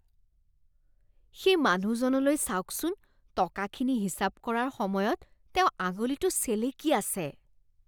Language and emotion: Assamese, disgusted